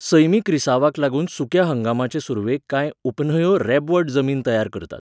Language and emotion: Goan Konkani, neutral